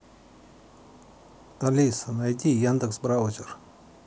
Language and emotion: Russian, neutral